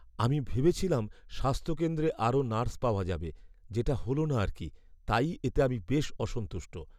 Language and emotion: Bengali, sad